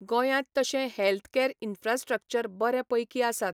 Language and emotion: Goan Konkani, neutral